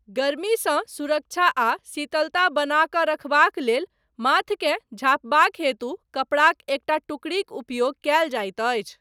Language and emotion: Maithili, neutral